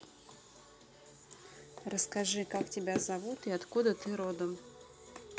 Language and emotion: Russian, neutral